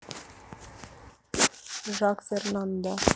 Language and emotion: Russian, neutral